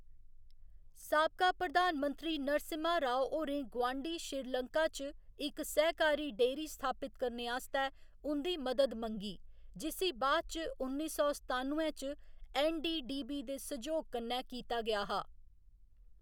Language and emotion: Dogri, neutral